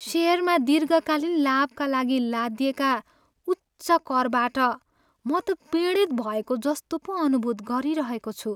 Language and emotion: Nepali, sad